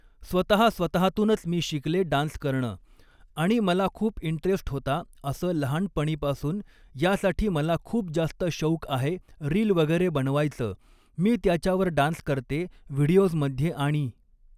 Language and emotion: Marathi, neutral